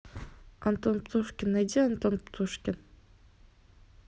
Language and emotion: Russian, neutral